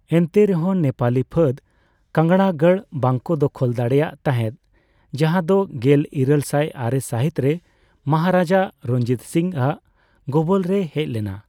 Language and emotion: Santali, neutral